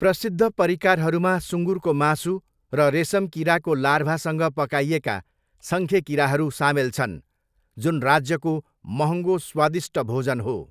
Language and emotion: Nepali, neutral